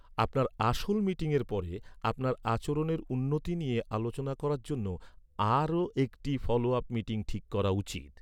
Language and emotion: Bengali, neutral